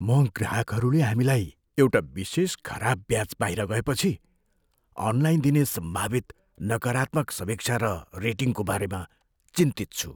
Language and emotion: Nepali, fearful